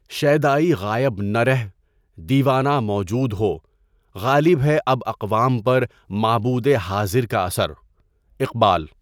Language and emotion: Urdu, neutral